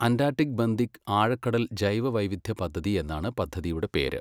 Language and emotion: Malayalam, neutral